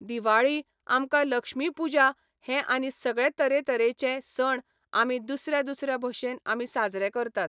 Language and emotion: Goan Konkani, neutral